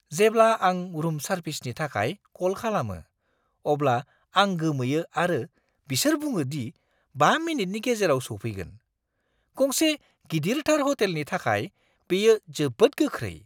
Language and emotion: Bodo, surprised